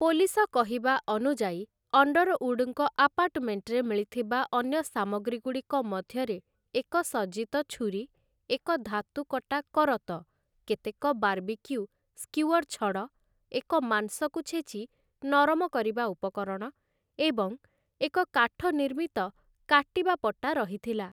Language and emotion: Odia, neutral